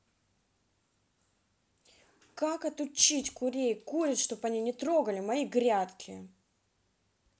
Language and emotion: Russian, angry